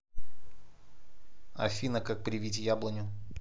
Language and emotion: Russian, neutral